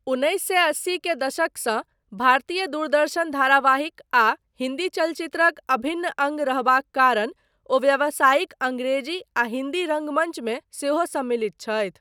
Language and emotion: Maithili, neutral